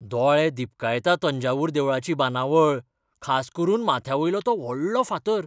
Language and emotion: Goan Konkani, surprised